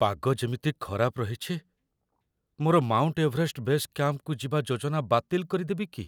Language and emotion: Odia, fearful